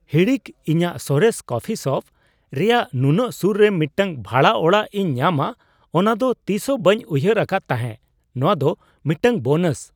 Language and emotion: Santali, surprised